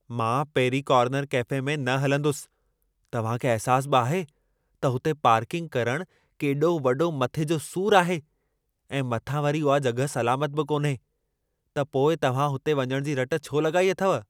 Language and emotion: Sindhi, angry